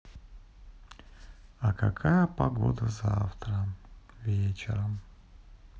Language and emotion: Russian, sad